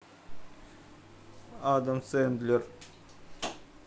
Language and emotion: Russian, neutral